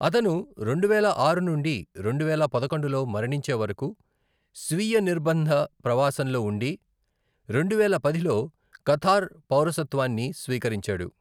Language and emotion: Telugu, neutral